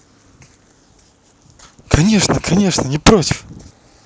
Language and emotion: Russian, positive